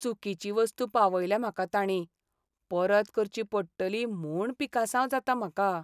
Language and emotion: Goan Konkani, sad